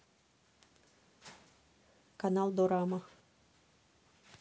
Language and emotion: Russian, neutral